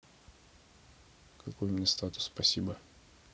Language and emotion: Russian, neutral